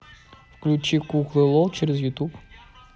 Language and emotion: Russian, neutral